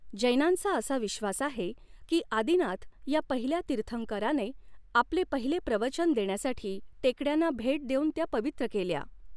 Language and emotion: Marathi, neutral